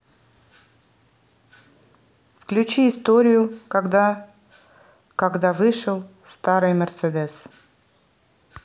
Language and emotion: Russian, neutral